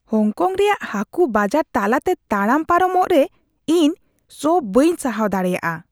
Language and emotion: Santali, disgusted